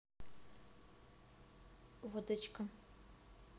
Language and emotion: Russian, neutral